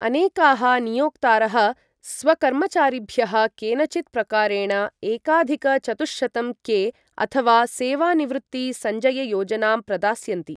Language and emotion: Sanskrit, neutral